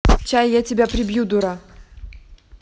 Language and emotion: Russian, neutral